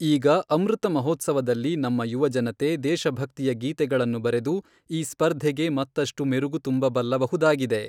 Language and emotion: Kannada, neutral